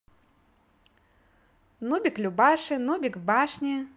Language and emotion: Russian, positive